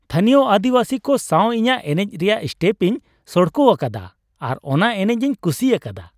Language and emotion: Santali, happy